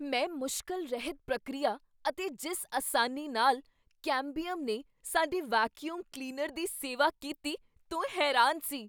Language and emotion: Punjabi, surprised